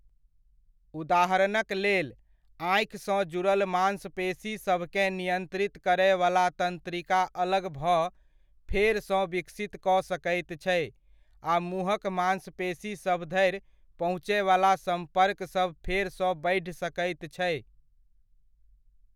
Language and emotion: Maithili, neutral